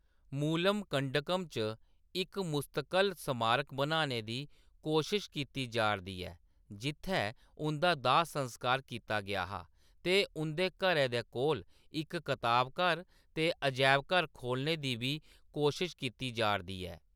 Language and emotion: Dogri, neutral